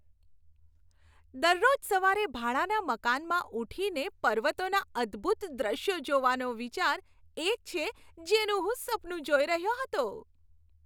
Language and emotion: Gujarati, happy